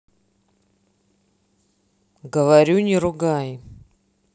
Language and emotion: Russian, neutral